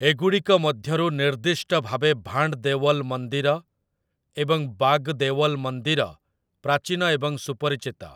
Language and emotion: Odia, neutral